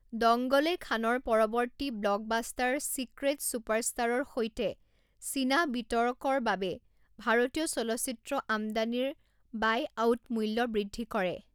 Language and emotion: Assamese, neutral